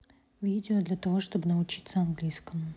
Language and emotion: Russian, neutral